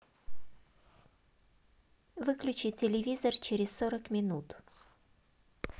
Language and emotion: Russian, neutral